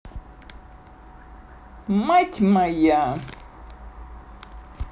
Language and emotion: Russian, positive